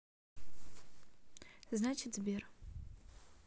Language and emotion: Russian, neutral